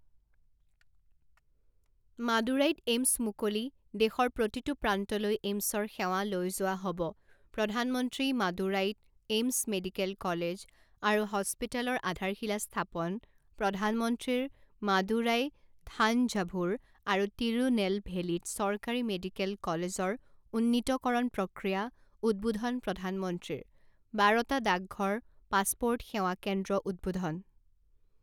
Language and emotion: Assamese, neutral